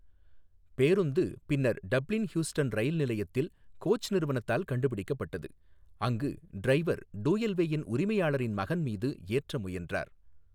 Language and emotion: Tamil, neutral